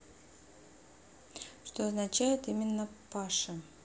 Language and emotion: Russian, neutral